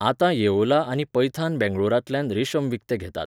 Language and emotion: Goan Konkani, neutral